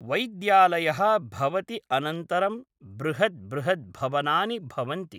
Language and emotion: Sanskrit, neutral